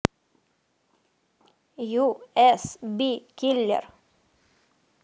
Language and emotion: Russian, neutral